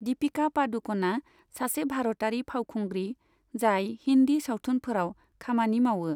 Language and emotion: Bodo, neutral